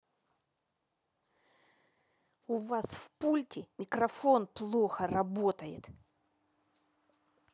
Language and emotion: Russian, angry